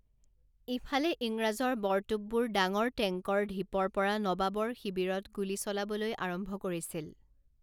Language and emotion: Assamese, neutral